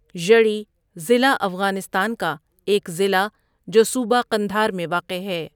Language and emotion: Urdu, neutral